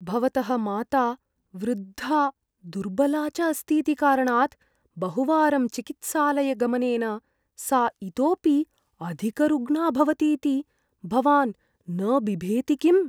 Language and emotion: Sanskrit, fearful